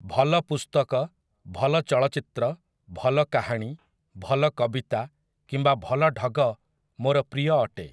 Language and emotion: Odia, neutral